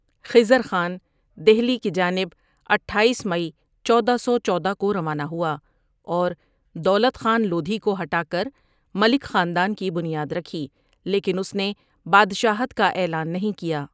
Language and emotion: Urdu, neutral